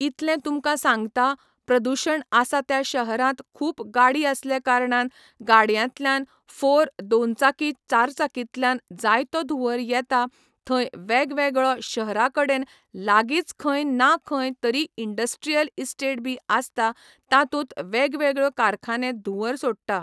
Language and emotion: Goan Konkani, neutral